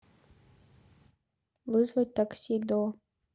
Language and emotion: Russian, neutral